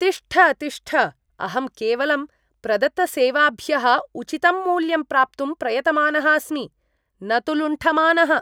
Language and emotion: Sanskrit, disgusted